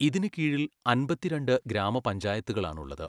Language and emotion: Malayalam, neutral